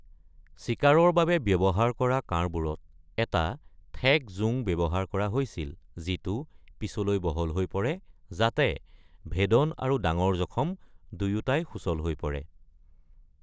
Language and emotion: Assamese, neutral